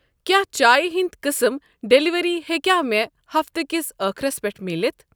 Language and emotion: Kashmiri, neutral